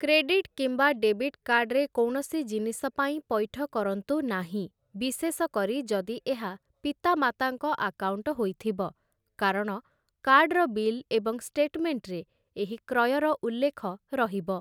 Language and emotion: Odia, neutral